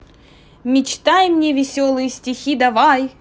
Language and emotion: Russian, positive